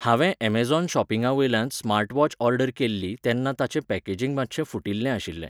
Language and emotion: Goan Konkani, neutral